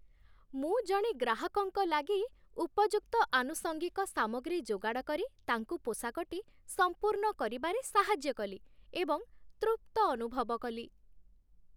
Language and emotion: Odia, happy